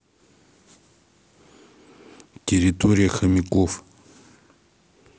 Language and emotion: Russian, neutral